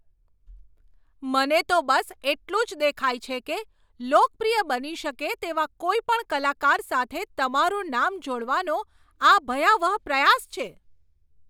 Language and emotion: Gujarati, angry